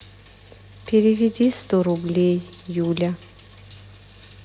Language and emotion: Russian, sad